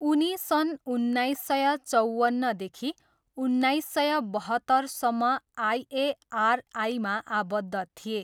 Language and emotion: Nepali, neutral